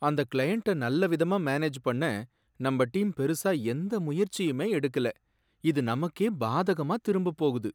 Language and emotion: Tamil, sad